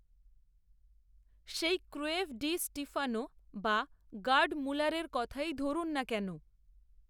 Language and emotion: Bengali, neutral